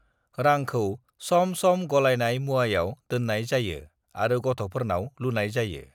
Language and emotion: Bodo, neutral